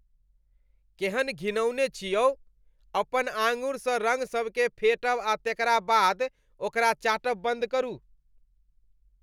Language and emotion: Maithili, disgusted